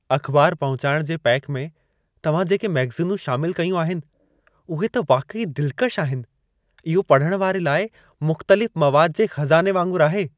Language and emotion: Sindhi, happy